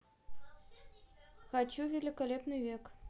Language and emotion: Russian, neutral